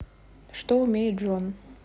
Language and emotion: Russian, neutral